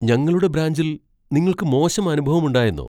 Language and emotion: Malayalam, surprised